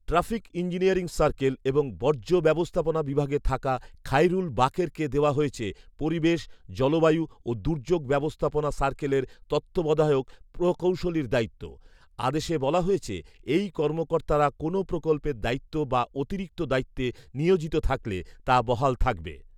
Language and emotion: Bengali, neutral